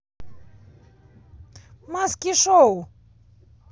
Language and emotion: Russian, positive